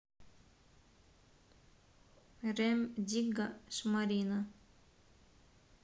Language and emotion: Russian, neutral